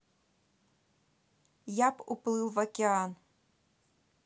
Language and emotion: Russian, neutral